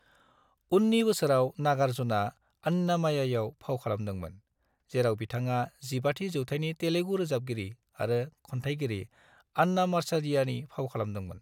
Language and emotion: Bodo, neutral